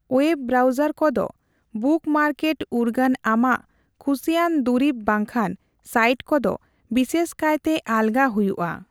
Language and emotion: Santali, neutral